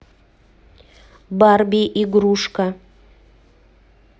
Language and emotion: Russian, neutral